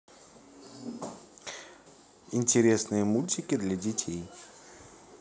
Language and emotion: Russian, neutral